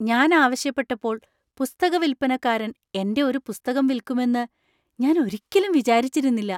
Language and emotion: Malayalam, surprised